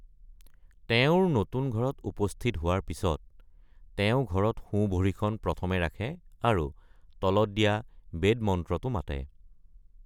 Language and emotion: Assamese, neutral